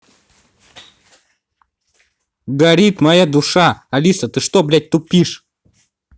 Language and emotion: Russian, angry